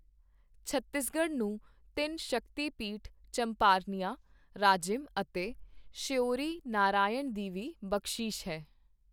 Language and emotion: Punjabi, neutral